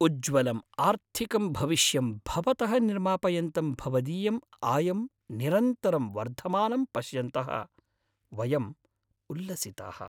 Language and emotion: Sanskrit, happy